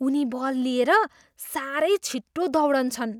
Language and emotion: Nepali, surprised